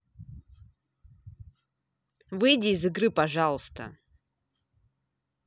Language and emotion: Russian, angry